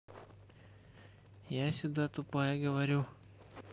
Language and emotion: Russian, neutral